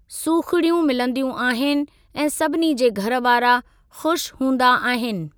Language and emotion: Sindhi, neutral